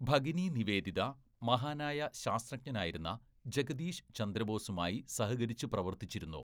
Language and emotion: Malayalam, neutral